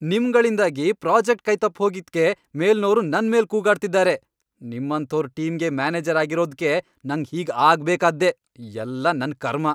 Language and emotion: Kannada, angry